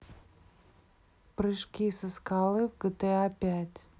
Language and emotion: Russian, neutral